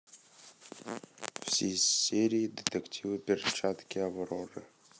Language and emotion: Russian, neutral